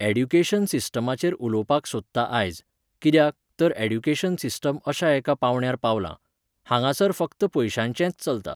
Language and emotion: Goan Konkani, neutral